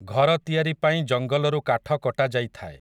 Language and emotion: Odia, neutral